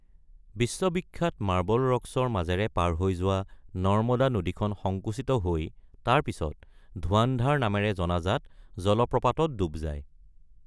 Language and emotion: Assamese, neutral